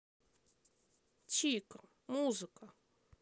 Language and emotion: Russian, neutral